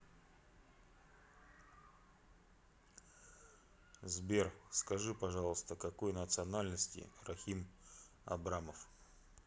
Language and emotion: Russian, neutral